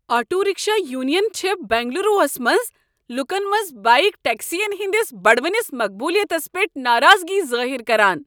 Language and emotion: Kashmiri, angry